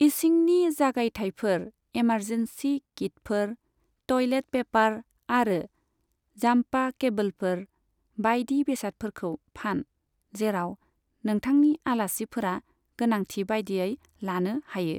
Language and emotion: Bodo, neutral